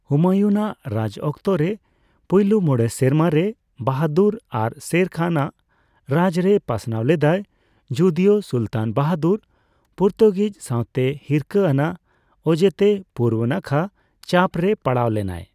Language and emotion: Santali, neutral